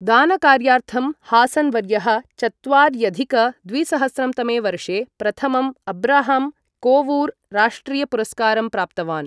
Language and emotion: Sanskrit, neutral